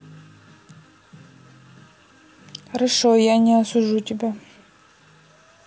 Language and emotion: Russian, neutral